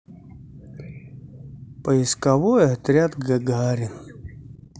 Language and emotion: Russian, sad